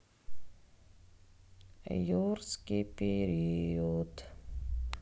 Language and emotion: Russian, sad